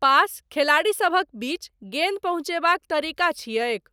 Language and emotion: Maithili, neutral